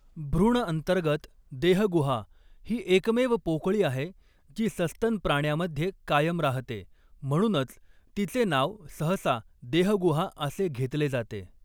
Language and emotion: Marathi, neutral